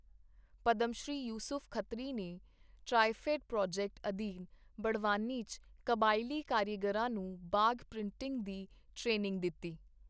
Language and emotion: Punjabi, neutral